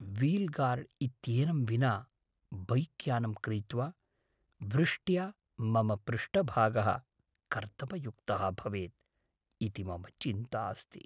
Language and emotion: Sanskrit, fearful